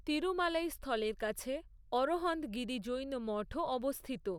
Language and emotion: Bengali, neutral